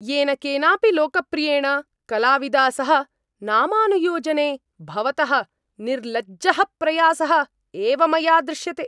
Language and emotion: Sanskrit, angry